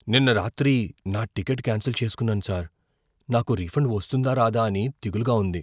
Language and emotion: Telugu, fearful